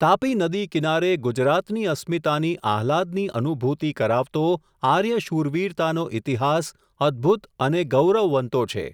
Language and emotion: Gujarati, neutral